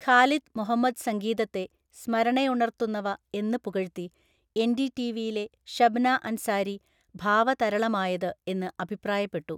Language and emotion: Malayalam, neutral